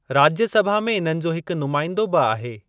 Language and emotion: Sindhi, neutral